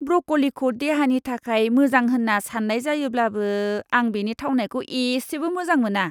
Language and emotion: Bodo, disgusted